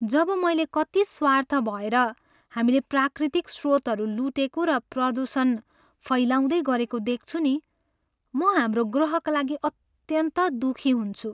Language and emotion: Nepali, sad